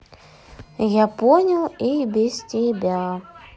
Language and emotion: Russian, neutral